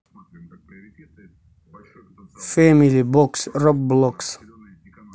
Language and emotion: Russian, neutral